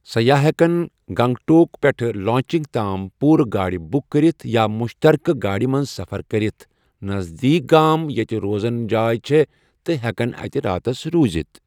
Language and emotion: Kashmiri, neutral